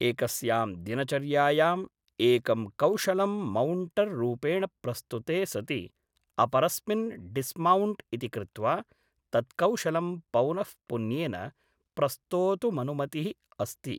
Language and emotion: Sanskrit, neutral